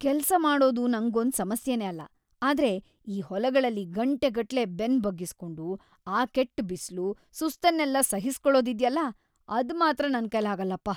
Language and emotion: Kannada, disgusted